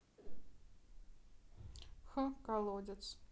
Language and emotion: Russian, neutral